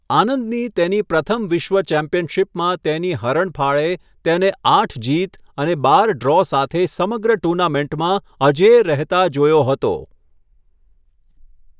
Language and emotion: Gujarati, neutral